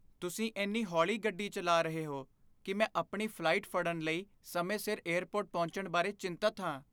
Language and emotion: Punjabi, fearful